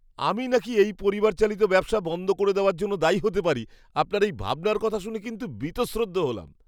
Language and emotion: Bengali, disgusted